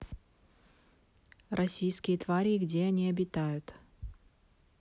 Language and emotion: Russian, neutral